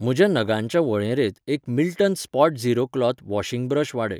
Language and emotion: Goan Konkani, neutral